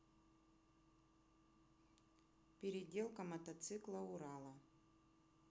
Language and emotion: Russian, neutral